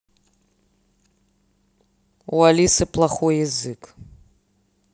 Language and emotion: Russian, neutral